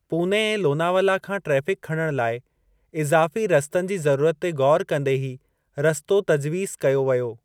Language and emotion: Sindhi, neutral